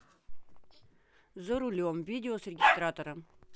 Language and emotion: Russian, neutral